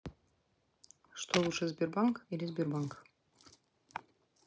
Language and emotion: Russian, neutral